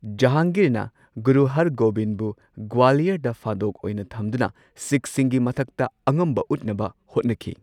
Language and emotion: Manipuri, neutral